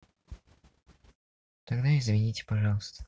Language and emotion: Russian, sad